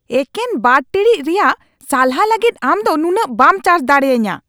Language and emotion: Santali, angry